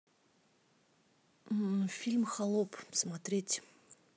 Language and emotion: Russian, neutral